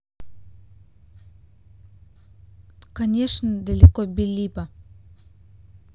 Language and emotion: Russian, neutral